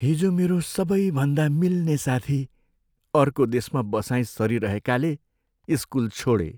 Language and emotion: Nepali, sad